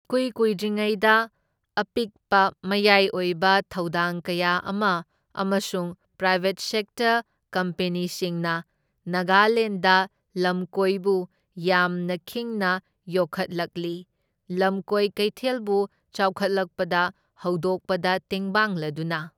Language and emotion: Manipuri, neutral